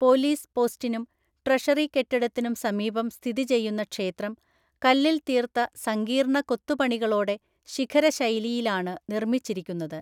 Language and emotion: Malayalam, neutral